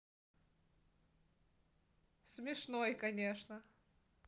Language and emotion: Russian, positive